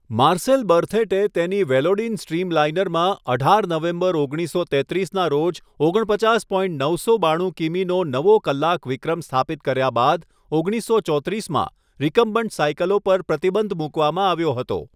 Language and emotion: Gujarati, neutral